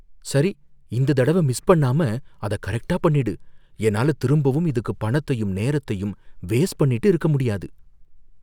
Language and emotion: Tamil, fearful